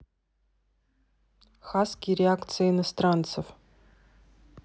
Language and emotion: Russian, neutral